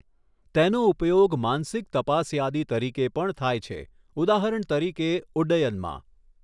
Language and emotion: Gujarati, neutral